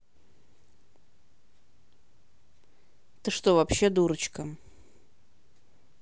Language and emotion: Russian, neutral